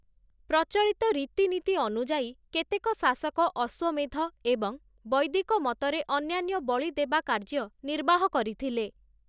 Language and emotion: Odia, neutral